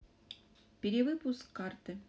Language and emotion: Russian, neutral